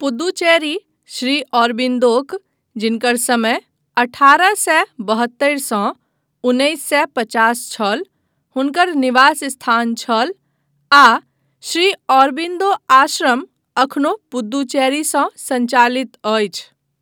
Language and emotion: Maithili, neutral